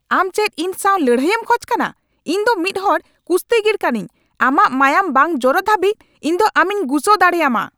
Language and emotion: Santali, angry